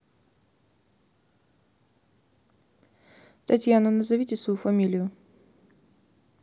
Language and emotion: Russian, neutral